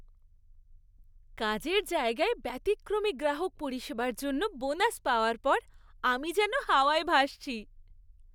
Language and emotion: Bengali, happy